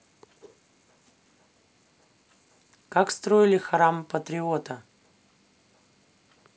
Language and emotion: Russian, neutral